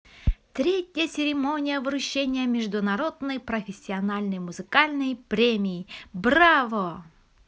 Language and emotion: Russian, positive